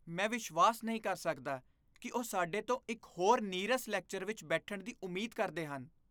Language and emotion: Punjabi, disgusted